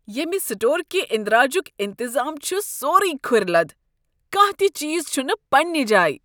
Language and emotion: Kashmiri, disgusted